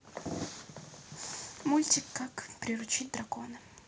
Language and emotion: Russian, neutral